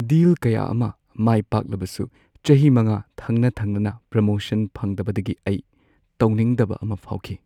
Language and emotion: Manipuri, sad